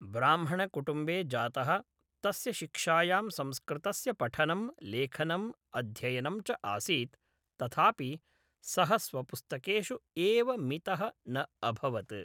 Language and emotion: Sanskrit, neutral